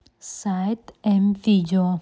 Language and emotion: Russian, neutral